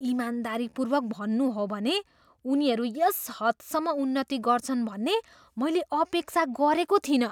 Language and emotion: Nepali, surprised